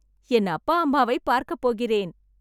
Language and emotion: Tamil, happy